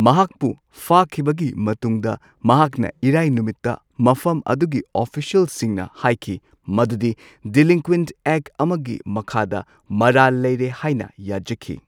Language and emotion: Manipuri, neutral